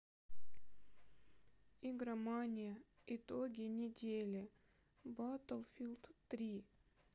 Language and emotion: Russian, sad